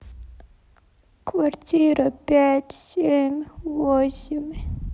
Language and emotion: Russian, sad